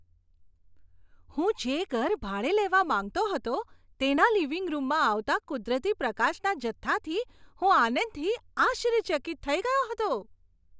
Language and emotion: Gujarati, surprised